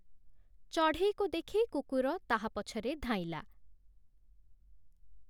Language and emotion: Odia, neutral